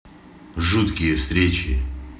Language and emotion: Russian, neutral